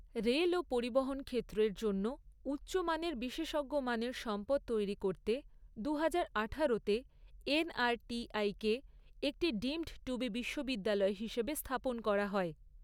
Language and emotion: Bengali, neutral